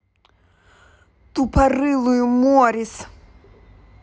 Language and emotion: Russian, angry